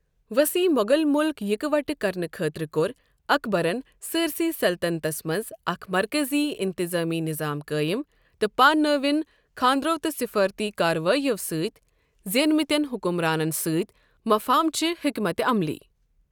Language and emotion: Kashmiri, neutral